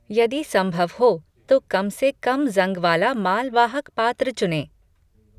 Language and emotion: Hindi, neutral